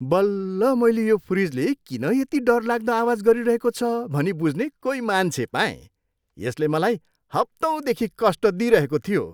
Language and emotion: Nepali, happy